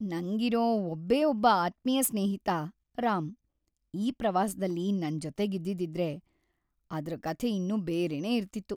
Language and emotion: Kannada, sad